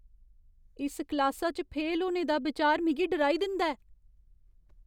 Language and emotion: Dogri, fearful